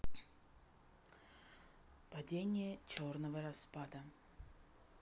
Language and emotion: Russian, neutral